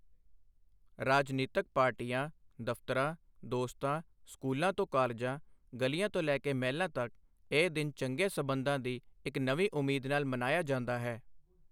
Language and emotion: Punjabi, neutral